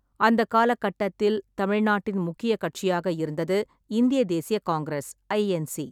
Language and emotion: Tamil, neutral